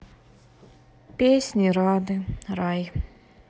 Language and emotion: Russian, sad